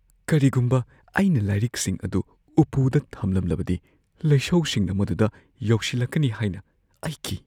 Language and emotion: Manipuri, fearful